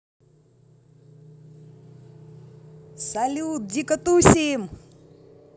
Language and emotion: Russian, positive